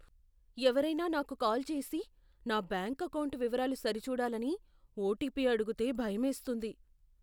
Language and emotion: Telugu, fearful